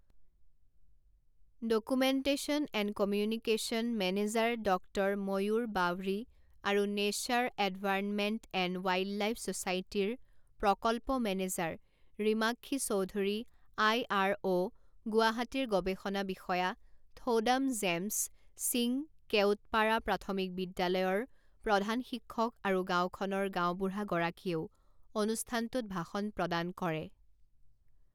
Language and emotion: Assamese, neutral